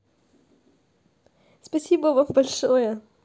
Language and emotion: Russian, positive